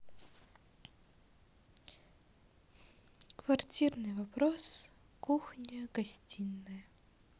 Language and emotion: Russian, sad